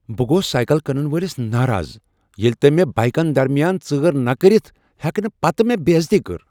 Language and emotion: Kashmiri, angry